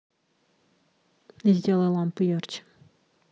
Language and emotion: Russian, neutral